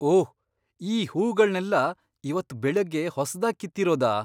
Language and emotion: Kannada, surprised